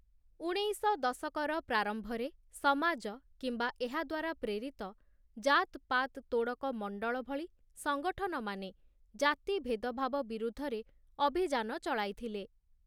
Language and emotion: Odia, neutral